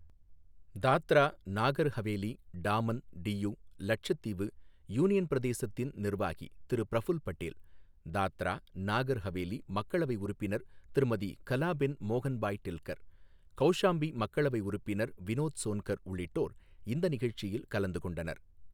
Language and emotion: Tamil, neutral